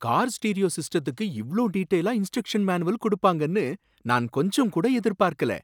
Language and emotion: Tamil, surprised